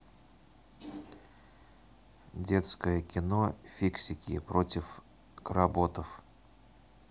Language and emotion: Russian, neutral